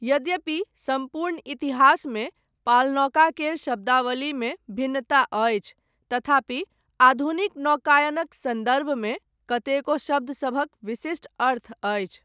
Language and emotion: Maithili, neutral